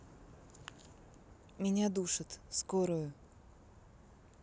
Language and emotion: Russian, neutral